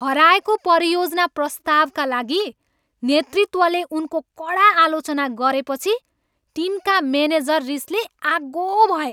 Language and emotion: Nepali, angry